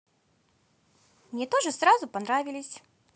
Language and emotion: Russian, positive